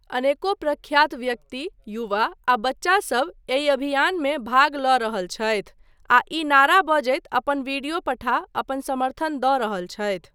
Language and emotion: Maithili, neutral